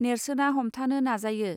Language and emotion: Bodo, neutral